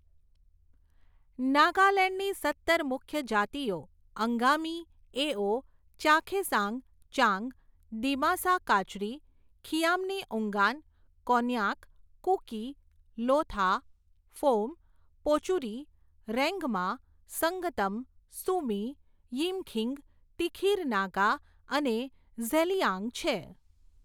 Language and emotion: Gujarati, neutral